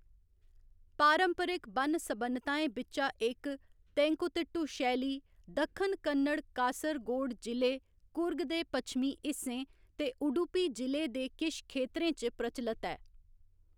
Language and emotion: Dogri, neutral